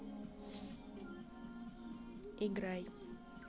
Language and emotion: Russian, neutral